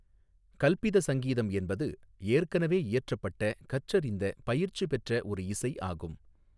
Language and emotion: Tamil, neutral